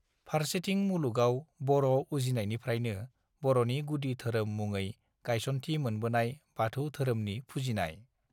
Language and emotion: Bodo, neutral